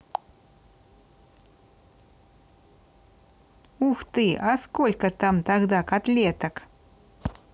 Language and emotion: Russian, positive